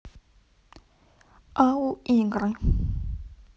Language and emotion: Russian, neutral